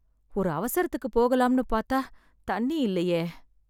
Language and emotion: Tamil, sad